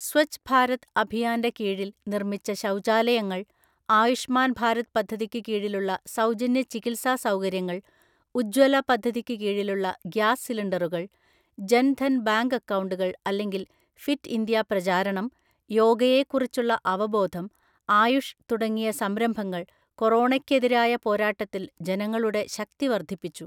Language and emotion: Malayalam, neutral